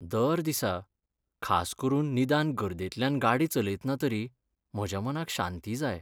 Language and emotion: Goan Konkani, sad